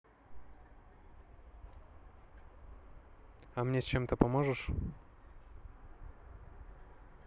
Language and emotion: Russian, neutral